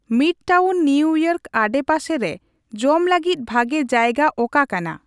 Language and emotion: Santali, neutral